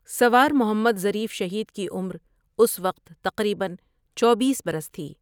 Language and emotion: Urdu, neutral